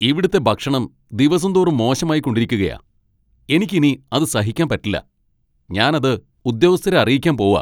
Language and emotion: Malayalam, angry